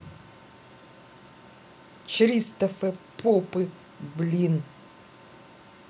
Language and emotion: Russian, angry